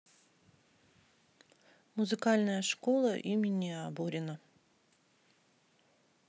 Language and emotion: Russian, neutral